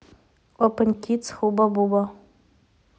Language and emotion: Russian, neutral